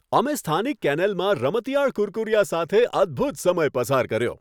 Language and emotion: Gujarati, happy